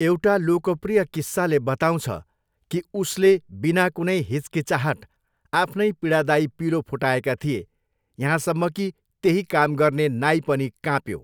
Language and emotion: Nepali, neutral